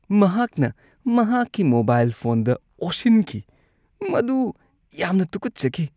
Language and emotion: Manipuri, disgusted